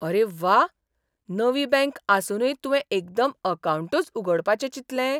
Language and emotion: Goan Konkani, surprised